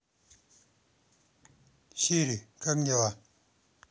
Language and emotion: Russian, neutral